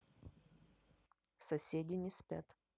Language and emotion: Russian, neutral